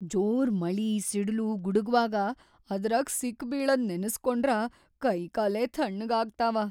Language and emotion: Kannada, fearful